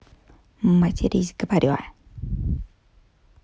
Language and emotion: Russian, angry